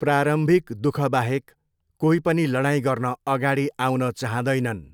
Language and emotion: Nepali, neutral